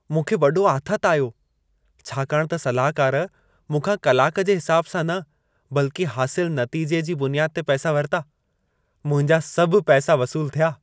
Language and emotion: Sindhi, happy